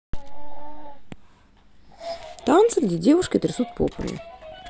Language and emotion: Russian, neutral